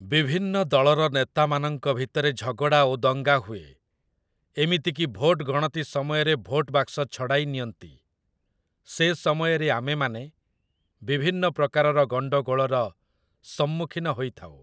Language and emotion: Odia, neutral